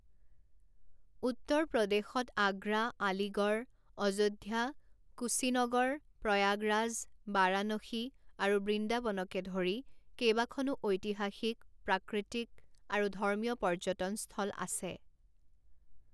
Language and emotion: Assamese, neutral